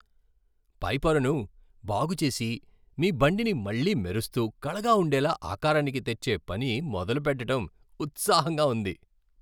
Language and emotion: Telugu, happy